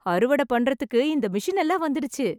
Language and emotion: Tamil, happy